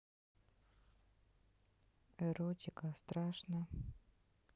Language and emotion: Russian, neutral